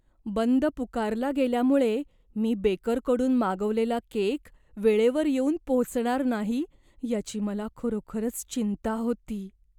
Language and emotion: Marathi, fearful